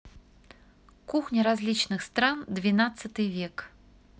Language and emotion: Russian, neutral